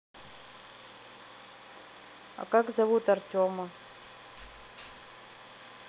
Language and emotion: Russian, neutral